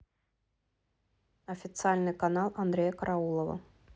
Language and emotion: Russian, neutral